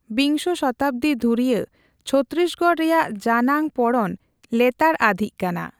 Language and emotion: Santali, neutral